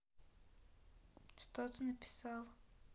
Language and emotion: Russian, neutral